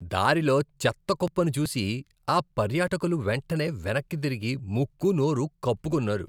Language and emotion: Telugu, disgusted